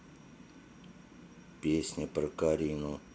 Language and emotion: Russian, neutral